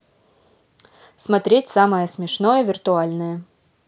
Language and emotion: Russian, neutral